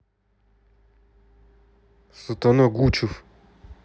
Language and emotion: Russian, angry